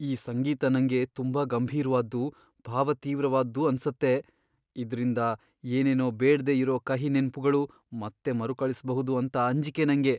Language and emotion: Kannada, fearful